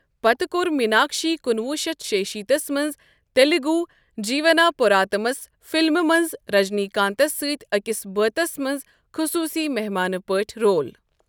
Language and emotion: Kashmiri, neutral